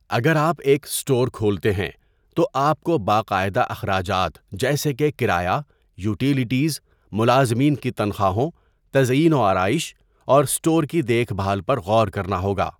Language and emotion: Urdu, neutral